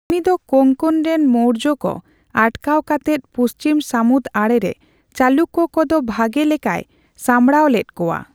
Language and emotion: Santali, neutral